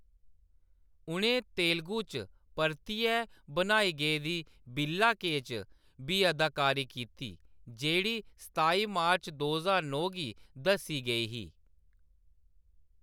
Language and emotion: Dogri, neutral